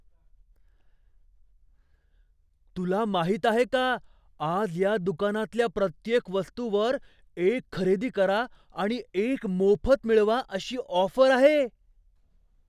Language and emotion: Marathi, surprised